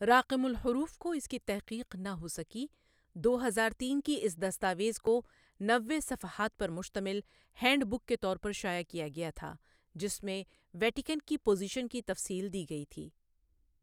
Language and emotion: Urdu, neutral